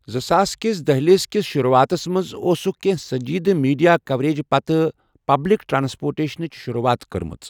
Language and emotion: Kashmiri, neutral